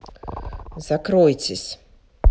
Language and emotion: Russian, angry